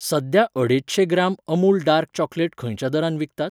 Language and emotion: Goan Konkani, neutral